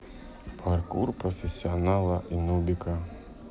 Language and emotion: Russian, neutral